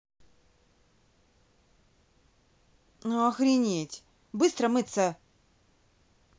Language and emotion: Russian, angry